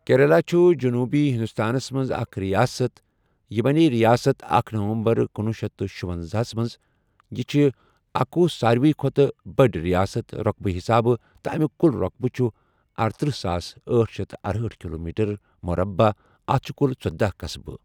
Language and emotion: Kashmiri, neutral